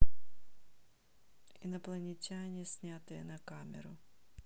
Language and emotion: Russian, neutral